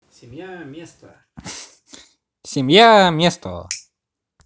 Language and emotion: Russian, positive